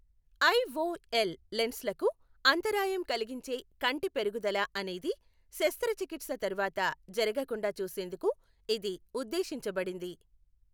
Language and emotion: Telugu, neutral